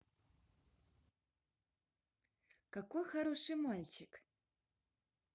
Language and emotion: Russian, positive